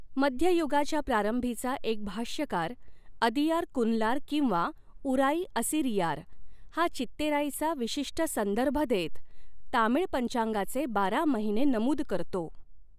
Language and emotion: Marathi, neutral